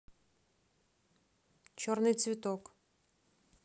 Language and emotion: Russian, neutral